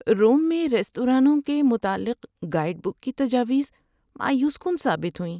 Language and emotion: Urdu, sad